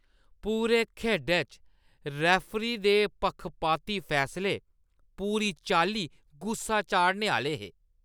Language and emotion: Dogri, disgusted